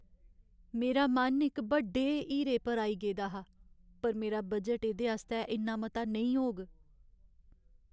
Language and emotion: Dogri, sad